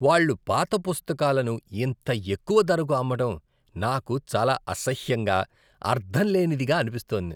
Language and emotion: Telugu, disgusted